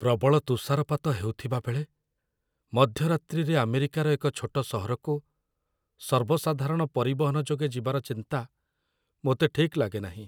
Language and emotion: Odia, fearful